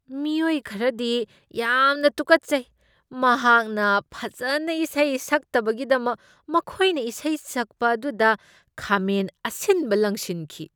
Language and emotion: Manipuri, disgusted